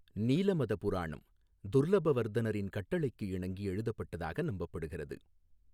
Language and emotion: Tamil, neutral